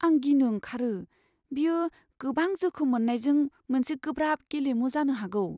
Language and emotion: Bodo, fearful